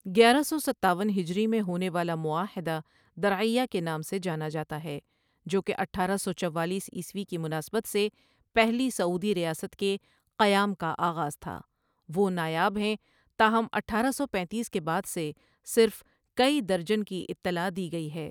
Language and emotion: Urdu, neutral